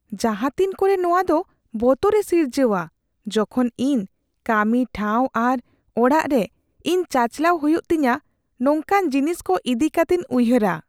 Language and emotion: Santali, fearful